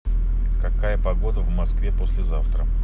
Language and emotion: Russian, neutral